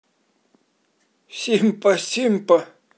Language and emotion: Russian, positive